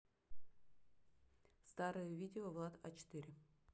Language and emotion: Russian, neutral